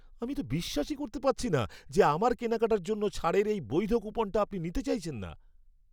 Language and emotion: Bengali, angry